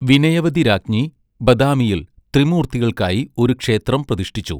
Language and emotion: Malayalam, neutral